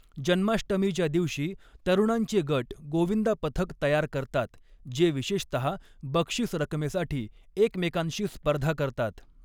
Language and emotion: Marathi, neutral